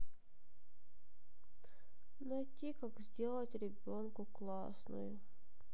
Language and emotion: Russian, sad